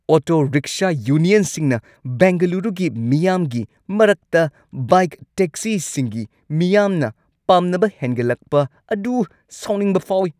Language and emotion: Manipuri, angry